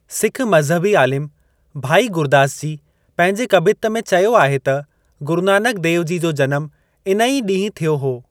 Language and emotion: Sindhi, neutral